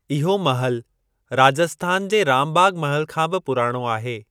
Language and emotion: Sindhi, neutral